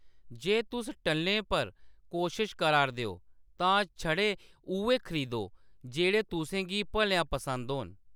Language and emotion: Dogri, neutral